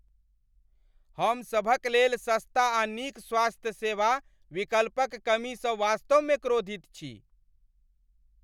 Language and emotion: Maithili, angry